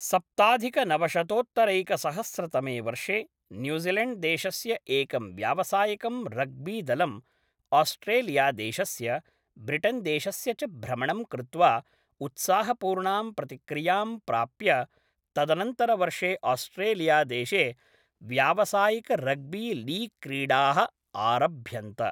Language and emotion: Sanskrit, neutral